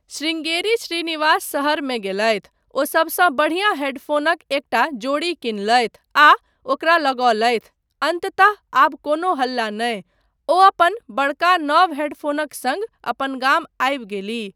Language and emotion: Maithili, neutral